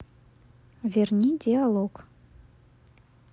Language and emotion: Russian, neutral